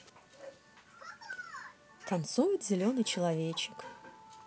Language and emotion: Russian, neutral